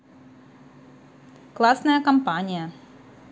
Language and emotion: Russian, positive